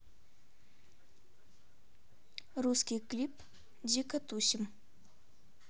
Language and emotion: Russian, neutral